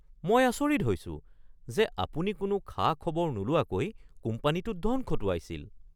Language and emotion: Assamese, surprised